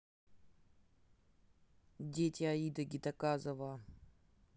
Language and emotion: Russian, neutral